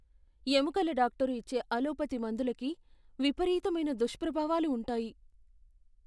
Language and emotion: Telugu, fearful